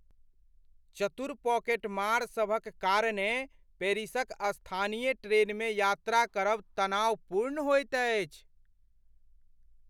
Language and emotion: Maithili, fearful